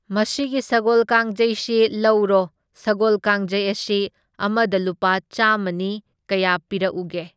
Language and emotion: Manipuri, neutral